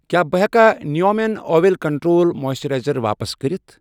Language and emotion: Kashmiri, neutral